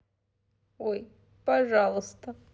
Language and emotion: Russian, sad